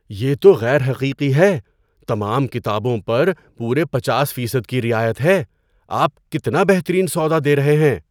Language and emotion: Urdu, surprised